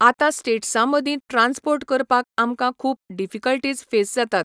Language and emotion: Goan Konkani, neutral